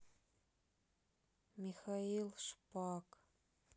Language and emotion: Russian, sad